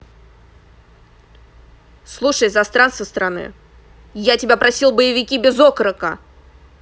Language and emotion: Russian, angry